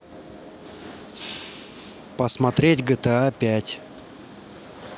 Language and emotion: Russian, neutral